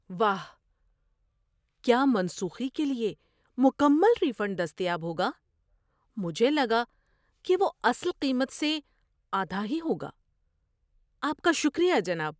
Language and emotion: Urdu, surprised